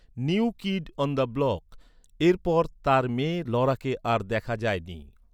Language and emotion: Bengali, neutral